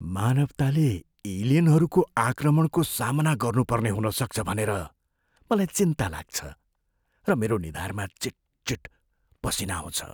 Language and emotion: Nepali, fearful